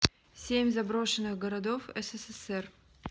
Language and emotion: Russian, neutral